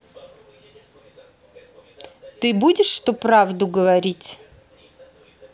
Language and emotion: Russian, neutral